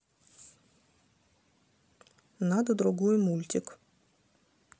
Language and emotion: Russian, neutral